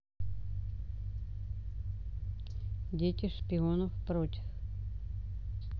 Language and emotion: Russian, neutral